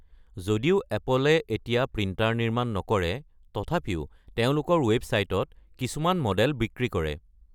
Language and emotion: Assamese, neutral